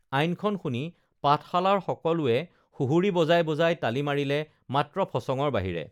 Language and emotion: Assamese, neutral